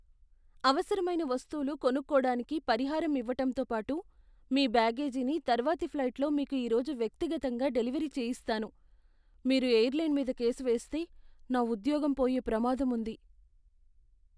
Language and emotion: Telugu, fearful